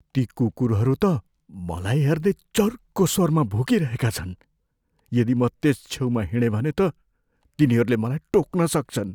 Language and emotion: Nepali, fearful